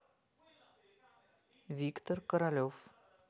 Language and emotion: Russian, neutral